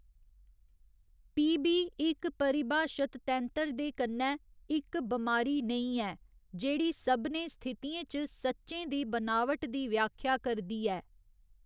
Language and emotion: Dogri, neutral